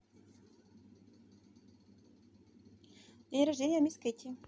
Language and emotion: Russian, neutral